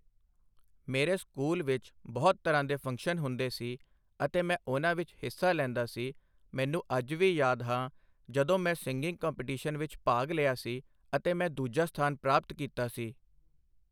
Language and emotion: Punjabi, neutral